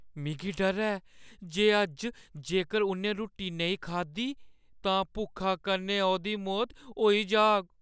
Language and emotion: Dogri, fearful